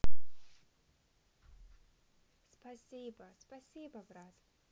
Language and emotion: Russian, positive